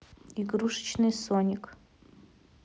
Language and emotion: Russian, neutral